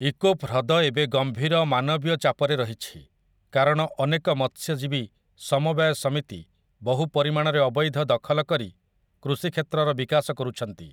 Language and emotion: Odia, neutral